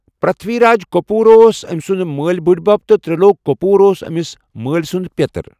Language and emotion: Kashmiri, neutral